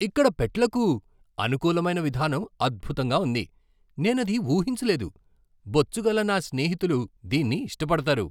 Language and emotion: Telugu, surprised